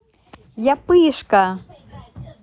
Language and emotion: Russian, positive